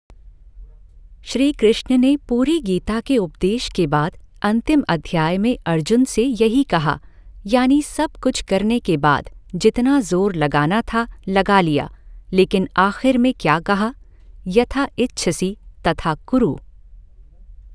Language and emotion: Hindi, neutral